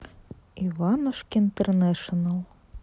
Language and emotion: Russian, neutral